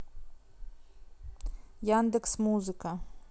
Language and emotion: Russian, neutral